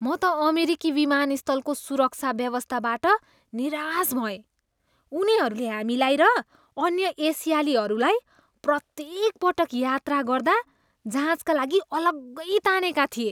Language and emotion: Nepali, disgusted